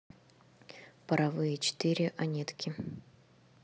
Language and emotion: Russian, neutral